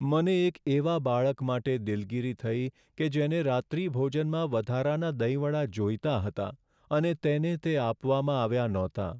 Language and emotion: Gujarati, sad